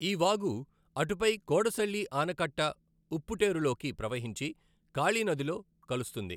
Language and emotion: Telugu, neutral